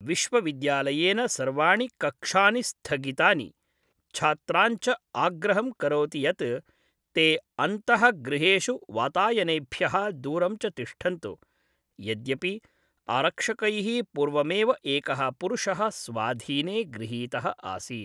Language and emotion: Sanskrit, neutral